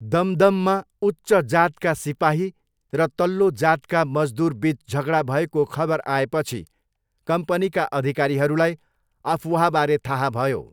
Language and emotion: Nepali, neutral